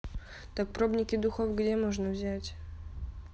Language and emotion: Russian, neutral